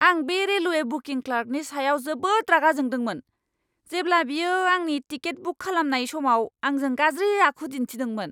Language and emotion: Bodo, angry